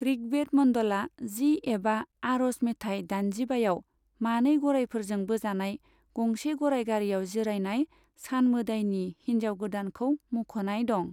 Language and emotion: Bodo, neutral